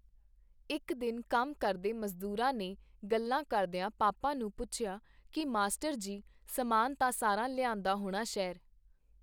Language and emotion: Punjabi, neutral